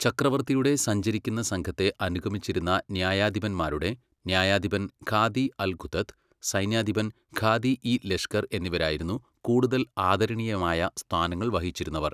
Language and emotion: Malayalam, neutral